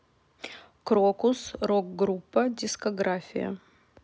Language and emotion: Russian, neutral